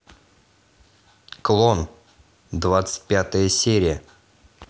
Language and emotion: Russian, neutral